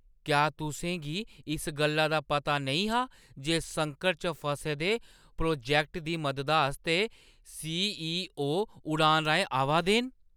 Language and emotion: Dogri, surprised